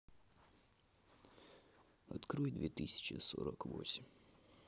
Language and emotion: Russian, sad